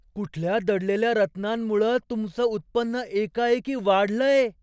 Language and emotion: Marathi, surprised